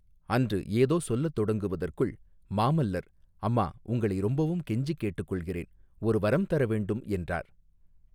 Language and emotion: Tamil, neutral